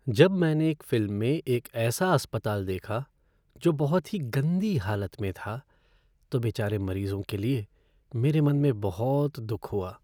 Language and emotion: Hindi, sad